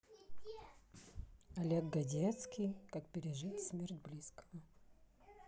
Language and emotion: Russian, neutral